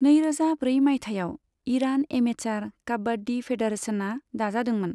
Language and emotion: Bodo, neutral